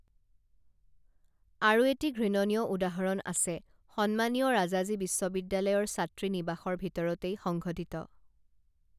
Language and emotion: Assamese, neutral